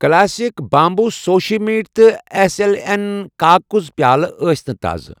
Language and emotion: Kashmiri, neutral